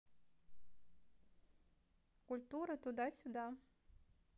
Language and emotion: Russian, neutral